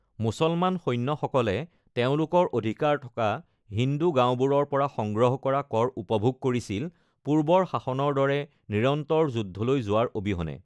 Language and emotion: Assamese, neutral